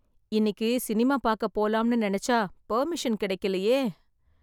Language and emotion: Tamil, sad